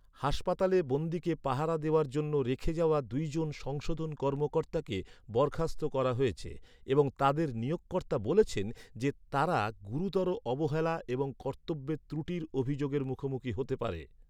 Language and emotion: Bengali, neutral